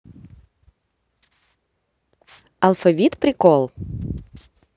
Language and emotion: Russian, positive